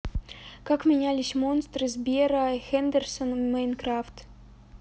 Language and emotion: Russian, neutral